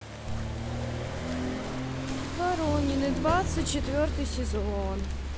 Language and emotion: Russian, sad